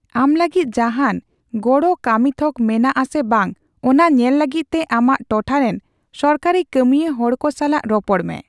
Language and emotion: Santali, neutral